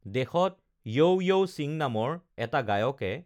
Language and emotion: Assamese, neutral